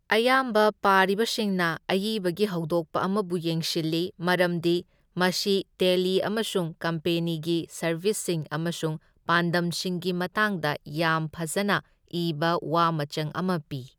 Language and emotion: Manipuri, neutral